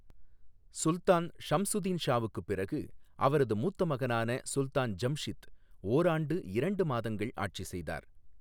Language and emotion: Tamil, neutral